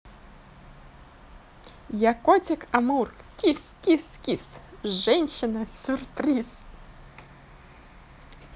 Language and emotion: Russian, positive